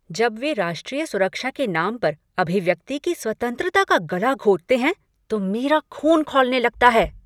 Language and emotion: Hindi, angry